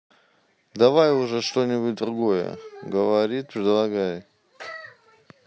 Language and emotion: Russian, neutral